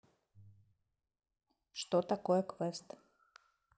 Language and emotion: Russian, neutral